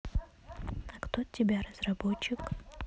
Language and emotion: Russian, neutral